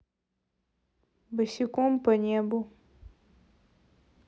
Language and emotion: Russian, neutral